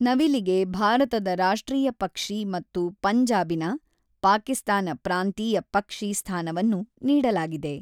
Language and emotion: Kannada, neutral